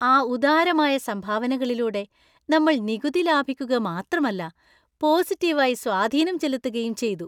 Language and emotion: Malayalam, happy